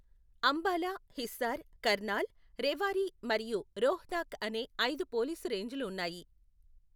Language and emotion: Telugu, neutral